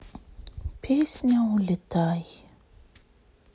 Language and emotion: Russian, sad